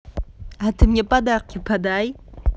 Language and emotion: Russian, positive